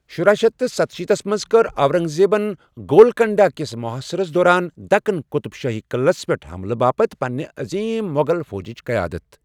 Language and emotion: Kashmiri, neutral